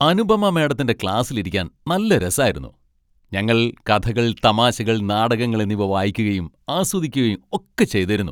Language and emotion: Malayalam, happy